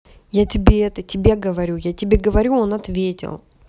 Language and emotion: Russian, angry